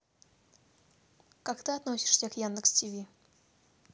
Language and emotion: Russian, neutral